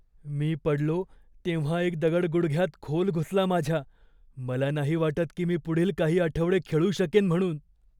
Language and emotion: Marathi, fearful